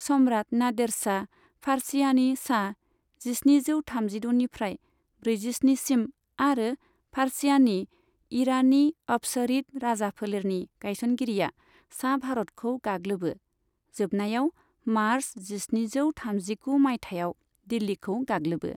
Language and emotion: Bodo, neutral